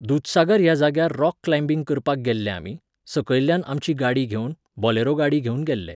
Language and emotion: Goan Konkani, neutral